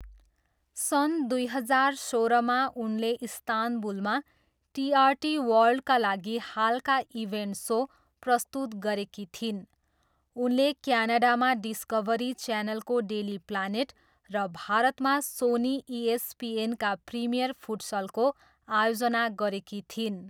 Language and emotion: Nepali, neutral